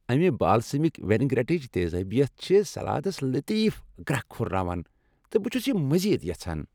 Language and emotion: Kashmiri, happy